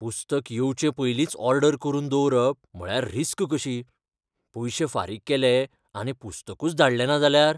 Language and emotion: Goan Konkani, fearful